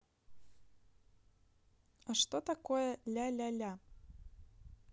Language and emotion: Russian, neutral